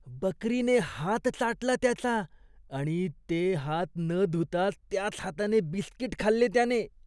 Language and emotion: Marathi, disgusted